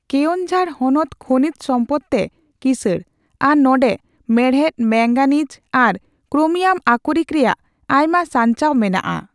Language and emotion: Santali, neutral